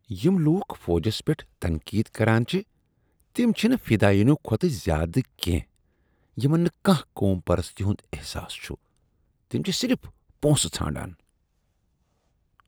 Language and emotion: Kashmiri, disgusted